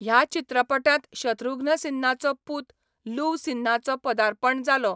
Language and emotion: Goan Konkani, neutral